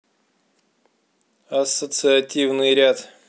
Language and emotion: Russian, neutral